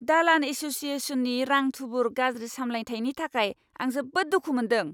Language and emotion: Bodo, angry